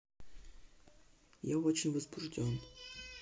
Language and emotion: Russian, neutral